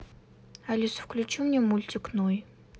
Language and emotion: Russian, neutral